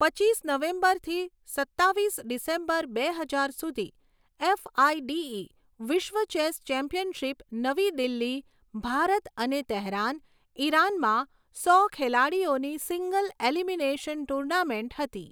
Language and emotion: Gujarati, neutral